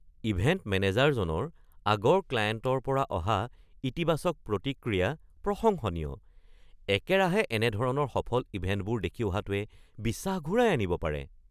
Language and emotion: Assamese, surprised